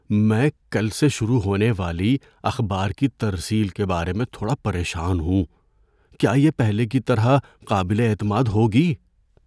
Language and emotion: Urdu, fearful